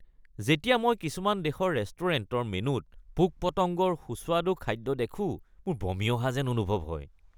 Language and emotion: Assamese, disgusted